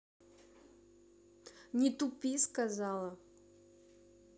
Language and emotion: Russian, angry